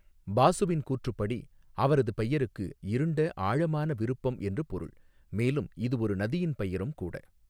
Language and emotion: Tamil, neutral